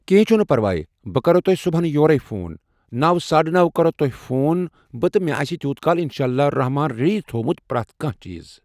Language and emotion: Kashmiri, neutral